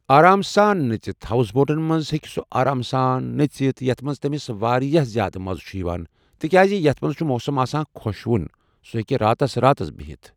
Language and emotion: Kashmiri, neutral